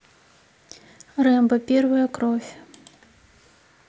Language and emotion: Russian, neutral